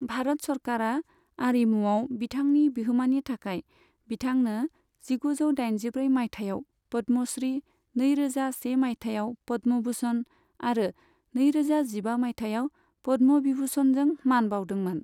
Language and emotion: Bodo, neutral